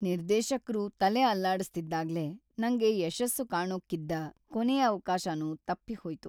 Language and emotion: Kannada, sad